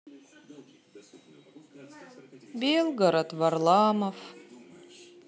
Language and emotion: Russian, sad